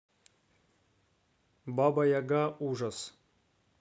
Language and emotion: Russian, neutral